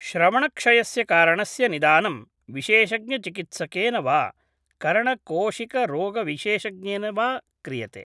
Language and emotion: Sanskrit, neutral